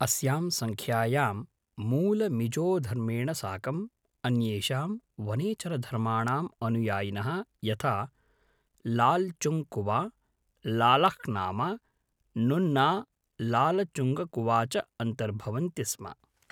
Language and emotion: Sanskrit, neutral